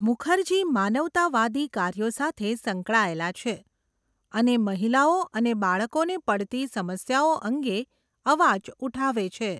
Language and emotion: Gujarati, neutral